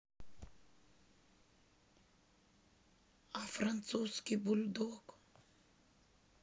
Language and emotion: Russian, sad